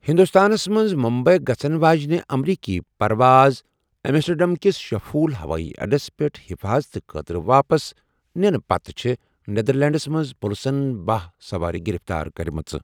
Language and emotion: Kashmiri, neutral